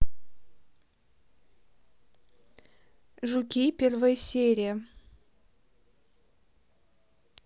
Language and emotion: Russian, neutral